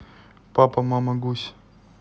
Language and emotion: Russian, neutral